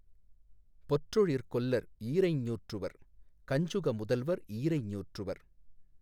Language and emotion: Tamil, neutral